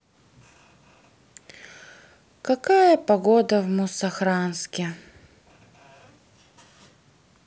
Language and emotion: Russian, sad